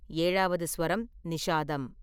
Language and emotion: Tamil, neutral